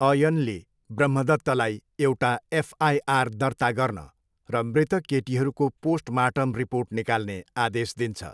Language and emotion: Nepali, neutral